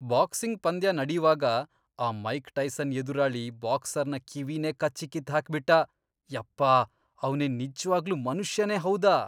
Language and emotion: Kannada, disgusted